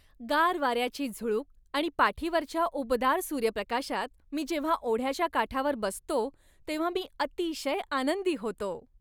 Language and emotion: Marathi, happy